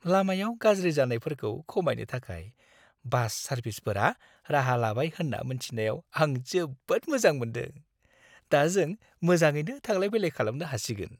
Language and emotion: Bodo, happy